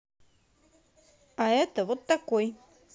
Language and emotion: Russian, positive